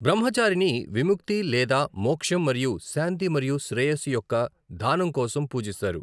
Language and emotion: Telugu, neutral